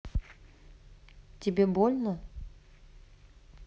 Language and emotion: Russian, neutral